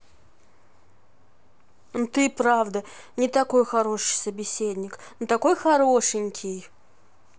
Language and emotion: Russian, positive